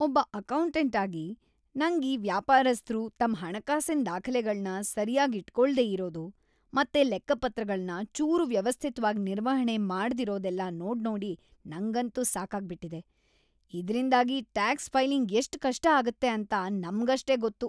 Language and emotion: Kannada, disgusted